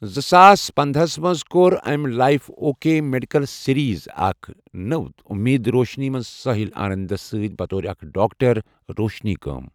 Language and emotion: Kashmiri, neutral